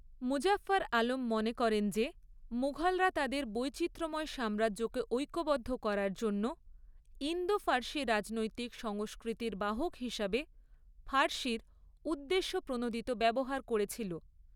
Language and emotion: Bengali, neutral